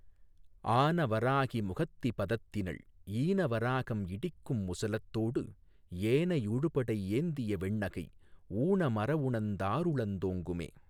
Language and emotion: Tamil, neutral